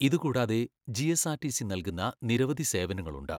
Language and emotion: Malayalam, neutral